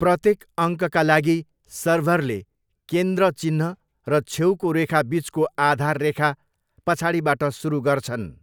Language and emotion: Nepali, neutral